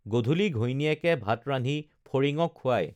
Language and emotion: Assamese, neutral